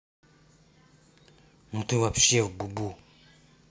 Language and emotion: Russian, angry